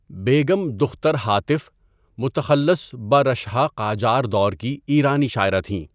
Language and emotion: Urdu, neutral